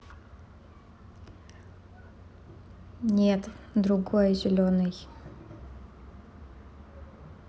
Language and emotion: Russian, neutral